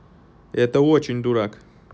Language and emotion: Russian, neutral